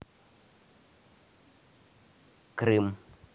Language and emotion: Russian, neutral